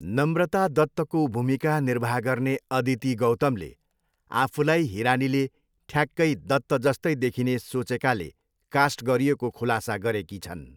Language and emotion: Nepali, neutral